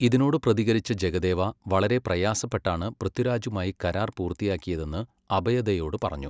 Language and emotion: Malayalam, neutral